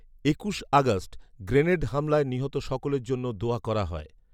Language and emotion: Bengali, neutral